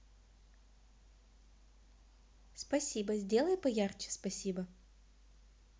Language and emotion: Russian, neutral